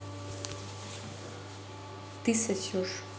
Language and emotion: Russian, neutral